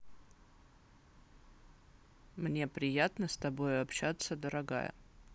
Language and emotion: Russian, neutral